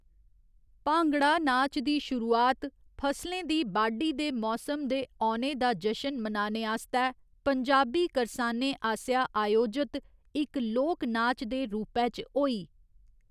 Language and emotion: Dogri, neutral